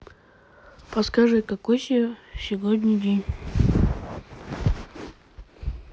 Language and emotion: Russian, neutral